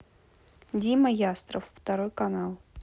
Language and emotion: Russian, neutral